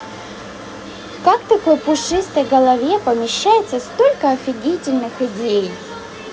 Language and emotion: Russian, positive